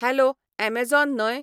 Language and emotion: Goan Konkani, neutral